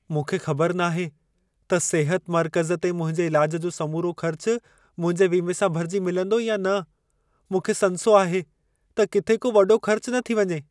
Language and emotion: Sindhi, fearful